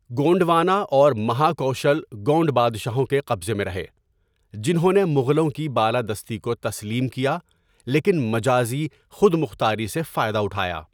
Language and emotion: Urdu, neutral